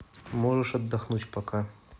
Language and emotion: Russian, neutral